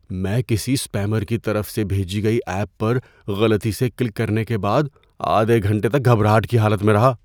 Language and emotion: Urdu, fearful